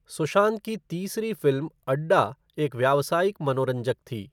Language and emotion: Hindi, neutral